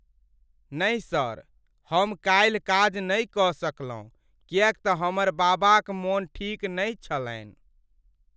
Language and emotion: Maithili, sad